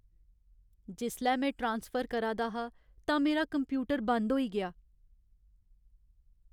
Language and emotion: Dogri, sad